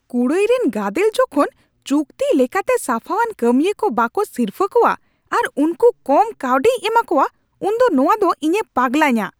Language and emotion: Santali, angry